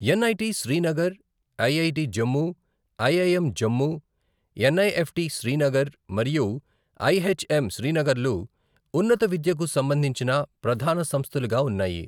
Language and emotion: Telugu, neutral